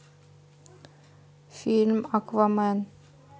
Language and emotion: Russian, neutral